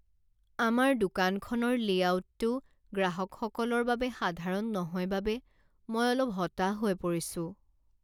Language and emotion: Assamese, sad